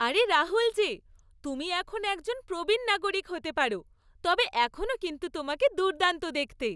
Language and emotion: Bengali, happy